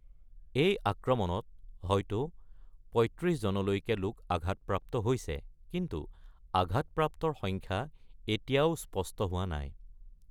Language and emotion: Assamese, neutral